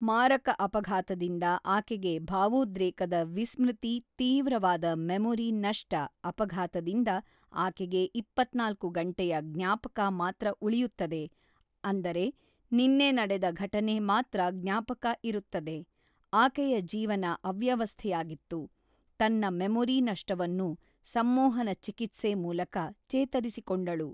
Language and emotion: Kannada, neutral